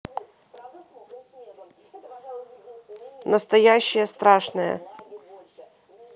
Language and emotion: Russian, neutral